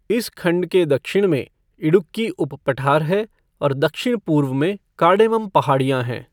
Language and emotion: Hindi, neutral